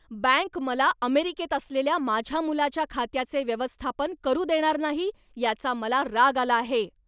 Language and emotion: Marathi, angry